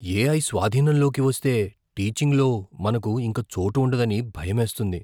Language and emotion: Telugu, fearful